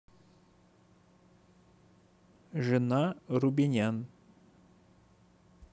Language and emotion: Russian, neutral